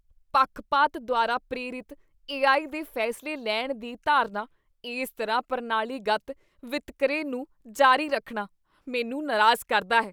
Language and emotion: Punjabi, disgusted